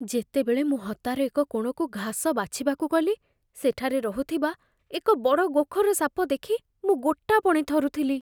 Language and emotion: Odia, fearful